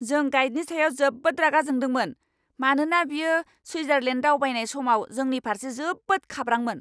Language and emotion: Bodo, angry